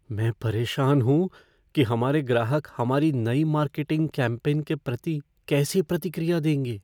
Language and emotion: Hindi, fearful